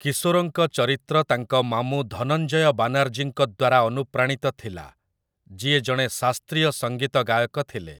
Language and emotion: Odia, neutral